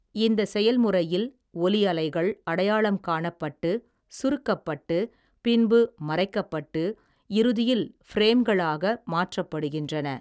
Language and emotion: Tamil, neutral